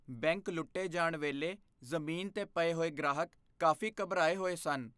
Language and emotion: Punjabi, fearful